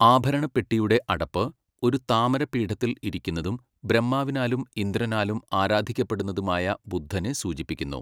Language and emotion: Malayalam, neutral